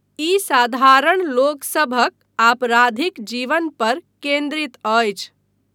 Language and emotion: Maithili, neutral